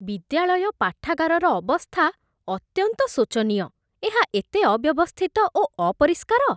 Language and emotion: Odia, disgusted